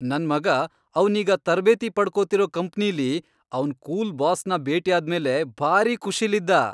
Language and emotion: Kannada, happy